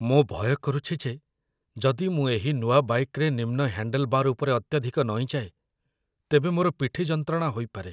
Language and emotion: Odia, fearful